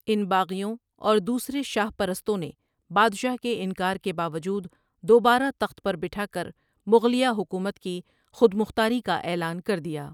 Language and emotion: Urdu, neutral